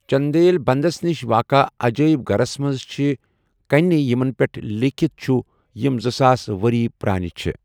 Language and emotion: Kashmiri, neutral